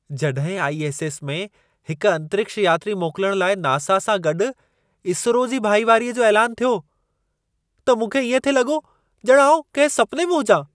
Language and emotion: Sindhi, surprised